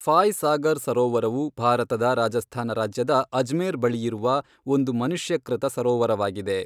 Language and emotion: Kannada, neutral